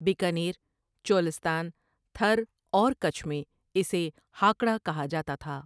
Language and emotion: Urdu, neutral